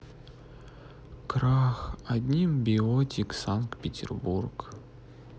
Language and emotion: Russian, sad